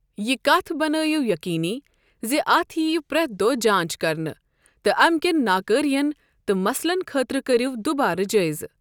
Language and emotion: Kashmiri, neutral